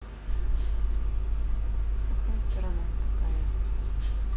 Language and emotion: Russian, neutral